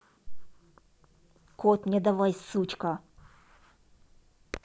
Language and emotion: Russian, angry